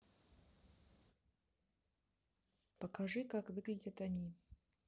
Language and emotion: Russian, neutral